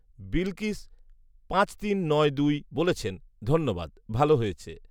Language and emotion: Bengali, neutral